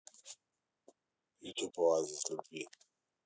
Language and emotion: Russian, neutral